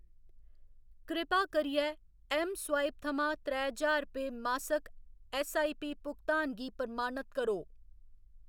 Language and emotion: Dogri, neutral